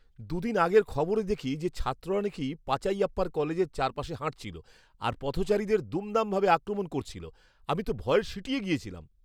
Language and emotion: Bengali, fearful